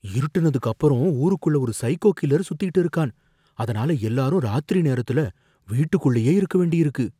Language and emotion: Tamil, fearful